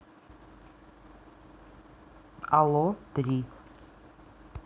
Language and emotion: Russian, neutral